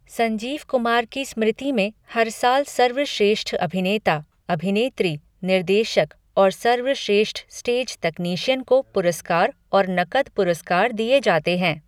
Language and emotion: Hindi, neutral